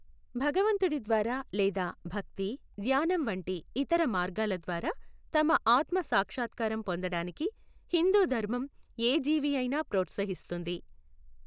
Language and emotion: Telugu, neutral